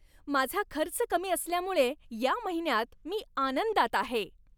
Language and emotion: Marathi, happy